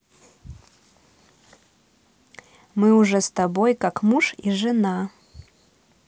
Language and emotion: Russian, neutral